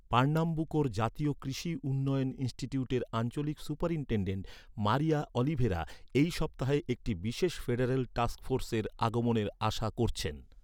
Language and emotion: Bengali, neutral